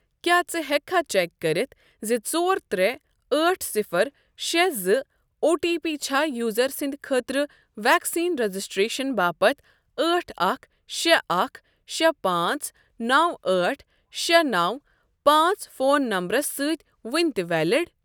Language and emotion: Kashmiri, neutral